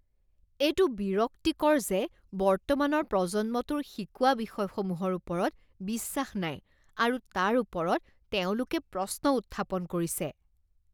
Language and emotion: Assamese, disgusted